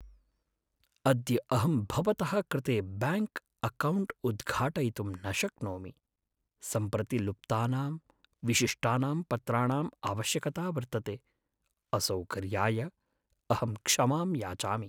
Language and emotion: Sanskrit, sad